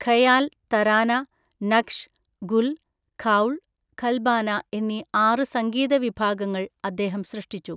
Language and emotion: Malayalam, neutral